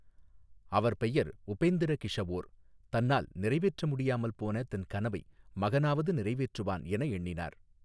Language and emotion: Tamil, neutral